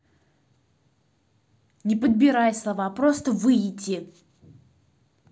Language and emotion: Russian, angry